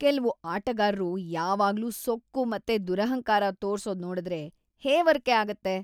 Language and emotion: Kannada, disgusted